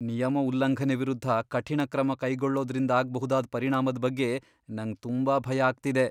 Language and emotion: Kannada, fearful